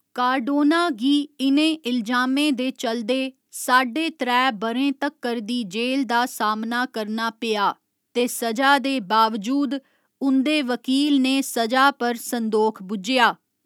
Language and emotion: Dogri, neutral